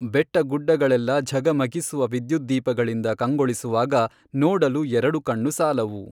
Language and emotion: Kannada, neutral